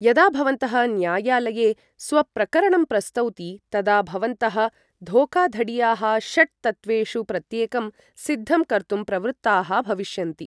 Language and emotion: Sanskrit, neutral